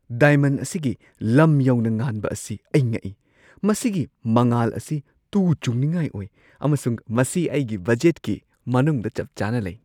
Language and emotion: Manipuri, surprised